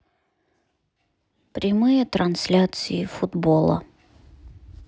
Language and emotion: Russian, sad